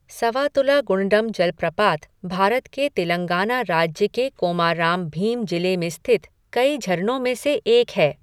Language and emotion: Hindi, neutral